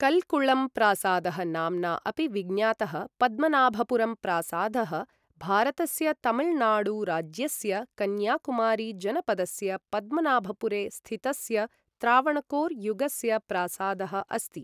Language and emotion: Sanskrit, neutral